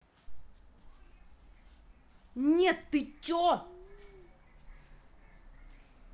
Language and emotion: Russian, angry